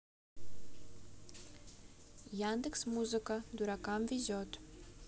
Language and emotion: Russian, neutral